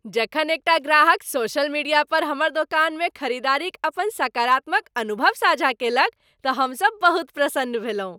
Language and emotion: Maithili, happy